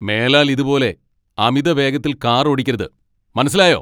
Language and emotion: Malayalam, angry